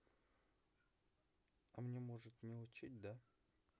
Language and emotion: Russian, sad